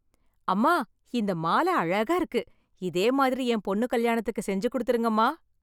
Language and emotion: Tamil, happy